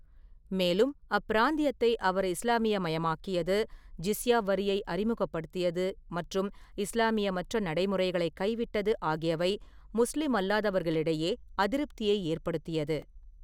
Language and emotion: Tamil, neutral